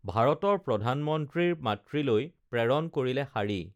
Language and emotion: Assamese, neutral